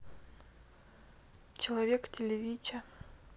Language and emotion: Russian, neutral